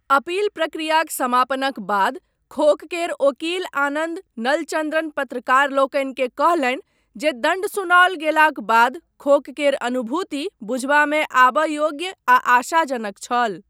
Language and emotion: Maithili, neutral